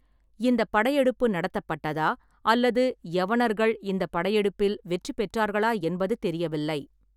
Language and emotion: Tamil, neutral